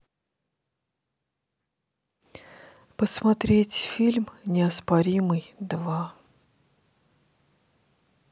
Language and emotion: Russian, sad